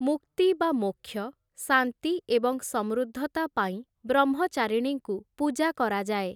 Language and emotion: Odia, neutral